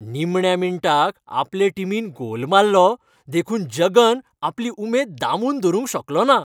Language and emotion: Goan Konkani, happy